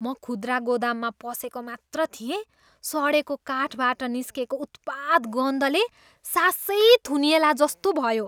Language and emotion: Nepali, disgusted